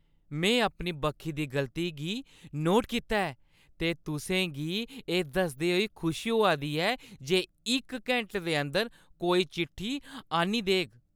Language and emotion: Dogri, happy